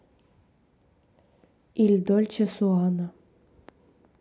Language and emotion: Russian, neutral